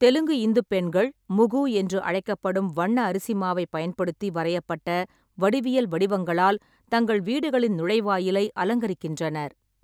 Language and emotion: Tamil, neutral